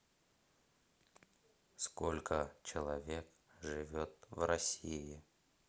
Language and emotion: Russian, neutral